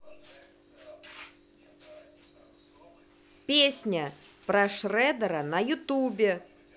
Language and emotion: Russian, angry